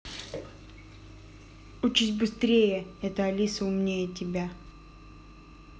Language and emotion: Russian, angry